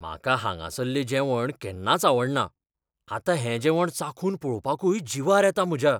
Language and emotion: Goan Konkani, fearful